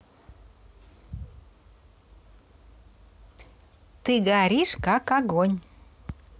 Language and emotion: Russian, positive